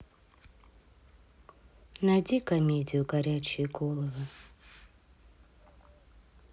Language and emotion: Russian, sad